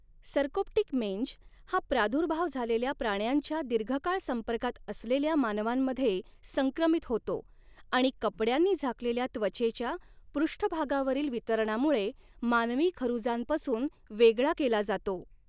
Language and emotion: Marathi, neutral